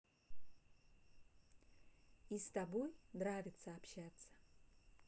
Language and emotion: Russian, neutral